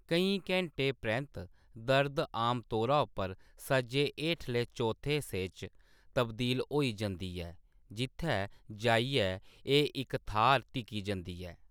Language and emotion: Dogri, neutral